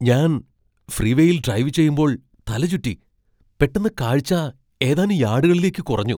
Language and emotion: Malayalam, surprised